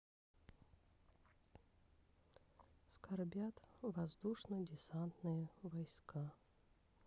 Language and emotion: Russian, sad